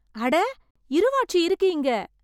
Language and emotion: Tamil, surprised